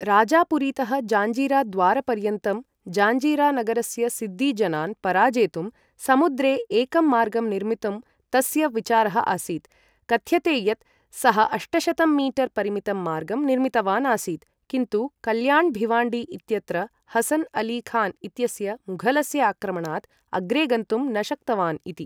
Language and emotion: Sanskrit, neutral